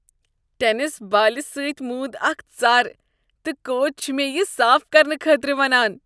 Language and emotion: Kashmiri, disgusted